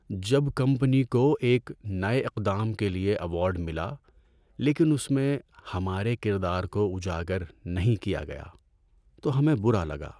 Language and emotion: Urdu, sad